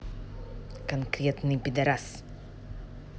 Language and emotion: Russian, angry